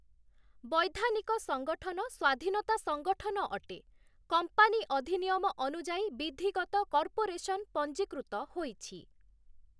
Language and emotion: Odia, neutral